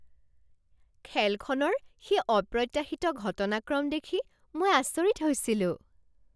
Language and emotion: Assamese, surprised